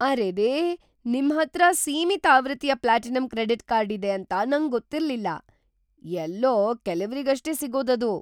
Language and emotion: Kannada, surprised